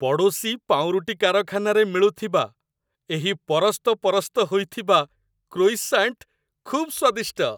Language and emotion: Odia, happy